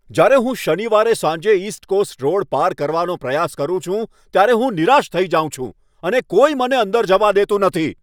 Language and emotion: Gujarati, angry